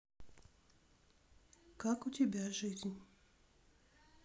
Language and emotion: Russian, neutral